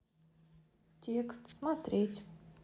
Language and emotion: Russian, neutral